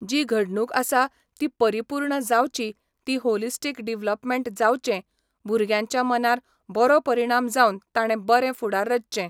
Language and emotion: Goan Konkani, neutral